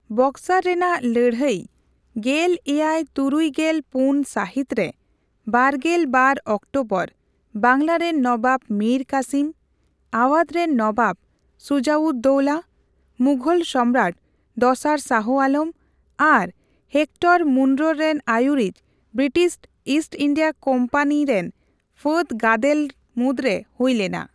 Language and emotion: Santali, neutral